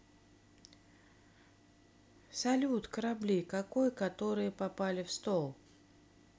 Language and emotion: Russian, neutral